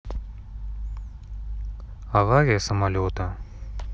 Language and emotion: Russian, neutral